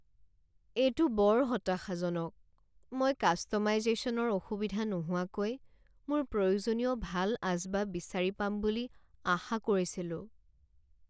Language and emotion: Assamese, sad